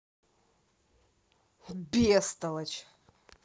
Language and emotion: Russian, angry